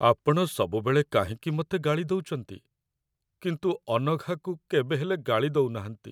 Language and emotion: Odia, sad